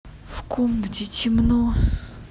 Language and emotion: Russian, sad